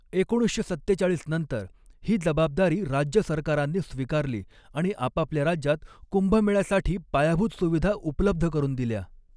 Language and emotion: Marathi, neutral